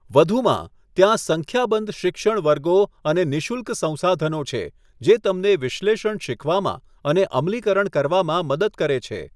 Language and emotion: Gujarati, neutral